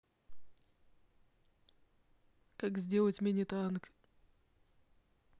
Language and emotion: Russian, neutral